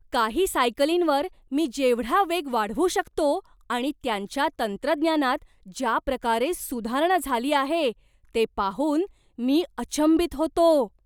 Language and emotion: Marathi, surprised